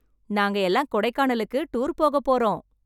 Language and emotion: Tamil, happy